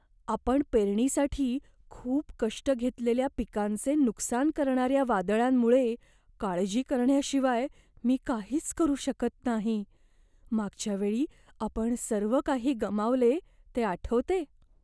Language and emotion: Marathi, fearful